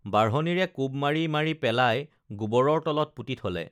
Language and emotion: Assamese, neutral